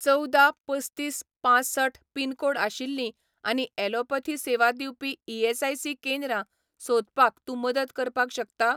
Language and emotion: Goan Konkani, neutral